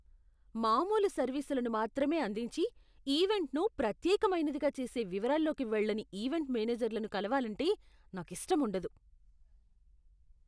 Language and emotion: Telugu, disgusted